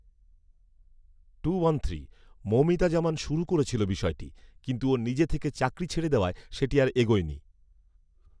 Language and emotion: Bengali, neutral